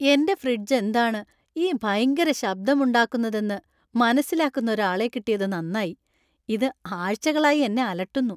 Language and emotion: Malayalam, happy